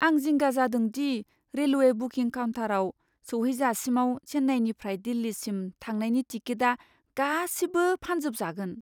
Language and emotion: Bodo, fearful